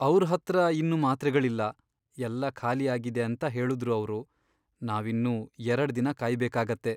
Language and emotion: Kannada, sad